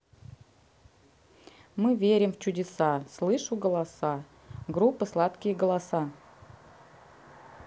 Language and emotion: Russian, neutral